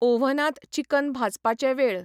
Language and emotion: Goan Konkani, neutral